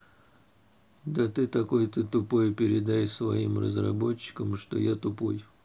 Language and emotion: Russian, neutral